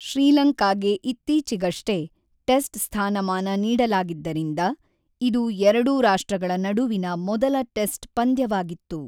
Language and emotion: Kannada, neutral